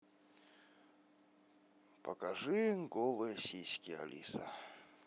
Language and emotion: Russian, sad